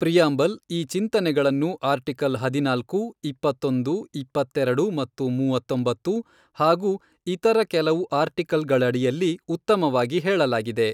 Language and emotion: Kannada, neutral